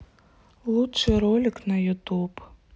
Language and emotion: Russian, sad